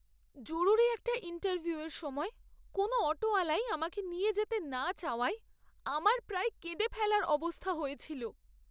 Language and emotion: Bengali, sad